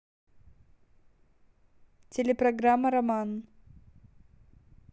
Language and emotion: Russian, neutral